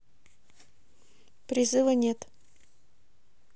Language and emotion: Russian, neutral